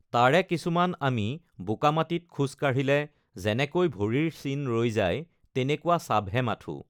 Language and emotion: Assamese, neutral